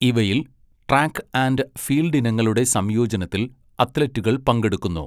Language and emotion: Malayalam, neutral